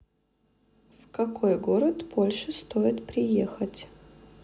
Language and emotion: Russian, neutral